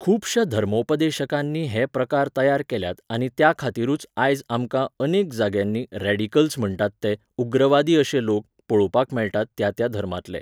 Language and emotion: Goan Konkani, neutral